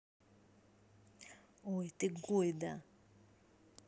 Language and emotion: Russian, angry